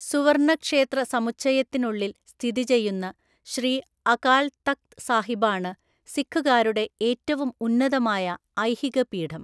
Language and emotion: Malayalam, neutral